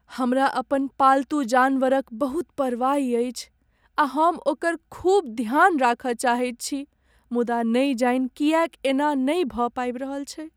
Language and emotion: Maithili, sad